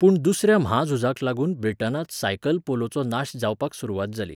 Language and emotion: Goan Konkani, neutral